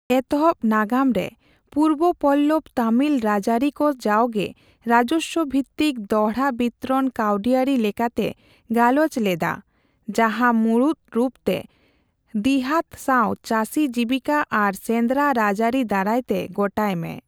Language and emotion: Santali, neutral